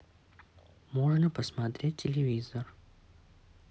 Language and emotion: Russian, neutral